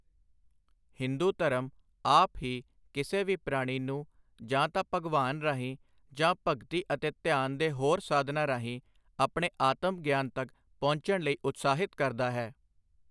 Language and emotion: Punjabi, neutral